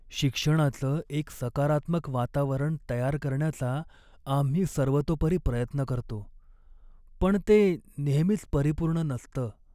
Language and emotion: Marathi, sad